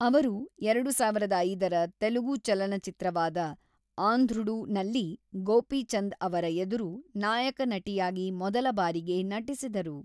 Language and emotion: Kannada, neutral